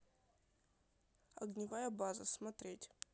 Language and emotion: Russian, neutral